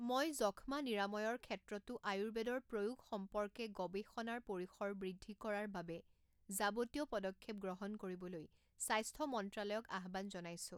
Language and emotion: Assamese, neutral